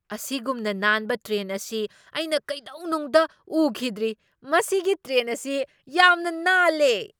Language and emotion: Manipuri, surprised